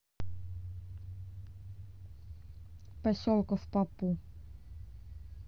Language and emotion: Russian, neutral